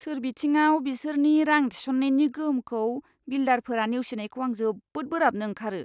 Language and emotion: Bodo, disgusted